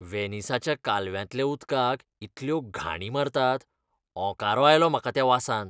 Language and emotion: Goan Konkani, disgusted